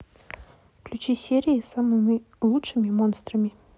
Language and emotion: Russian, neutral